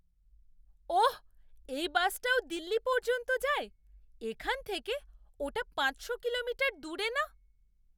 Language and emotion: Bengali, surprised